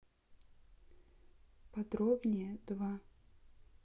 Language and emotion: Russian, neutral